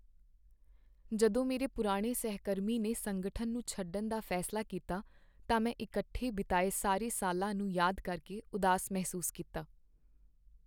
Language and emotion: Punjabi, sad